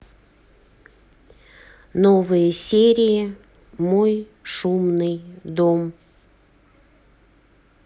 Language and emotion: Russian, neutral